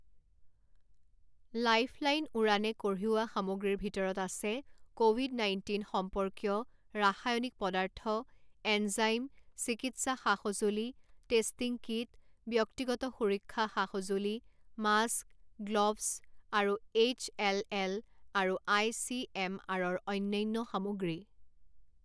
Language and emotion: Assamese, neutral